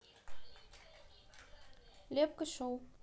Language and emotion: Russian, neutral